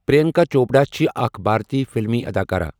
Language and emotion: Kashmiri, neutral